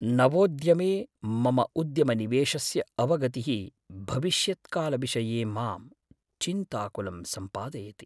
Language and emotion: Sanskrit, fearful